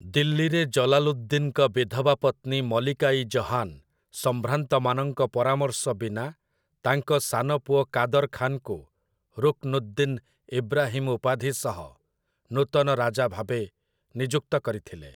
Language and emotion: Odia, neutral